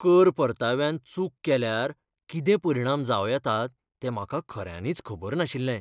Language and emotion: Goan Konkani, fearful